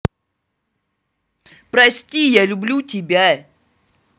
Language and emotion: Russian, angry